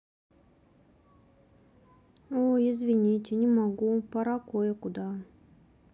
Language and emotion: Russian, sad